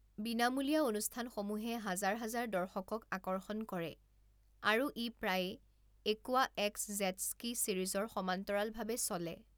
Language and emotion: Assamese, neutral